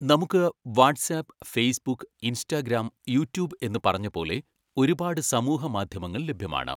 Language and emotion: Malayalam, neutral